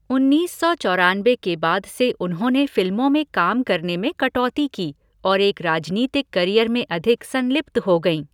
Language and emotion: Hindi, neutral